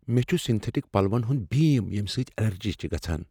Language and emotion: Kashmiri, fearful